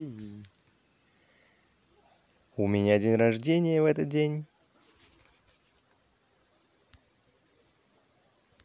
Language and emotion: Russian, positive